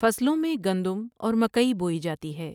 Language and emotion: Urdu, neutral